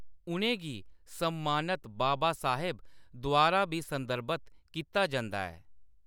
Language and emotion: Dogri, neutral